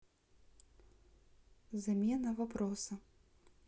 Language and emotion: Russian, neutral